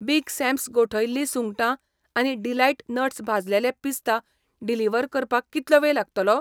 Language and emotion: Goan Konkani, neutral